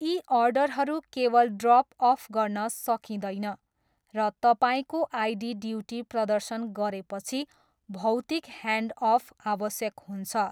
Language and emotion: Nepali, neutral